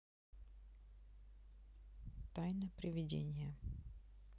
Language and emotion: Russian, neutral